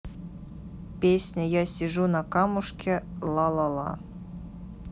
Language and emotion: Russian, neutral